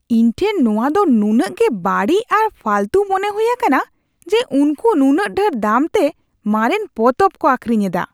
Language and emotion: Santali, disgusted